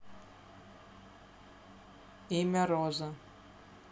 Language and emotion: Russian, neutral